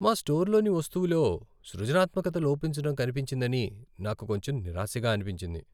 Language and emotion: Telugu, sad